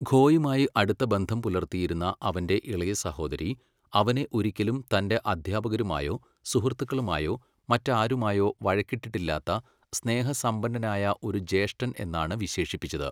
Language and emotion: Malayalam, neutral